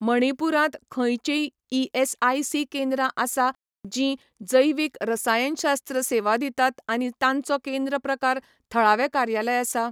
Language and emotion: Goan Konkani, neutral